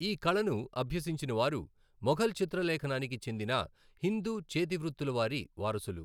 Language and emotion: Telugu, neutral